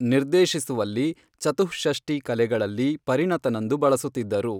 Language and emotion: Kannada, neutral